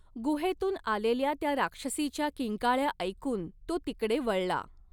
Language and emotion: Marathi, neutral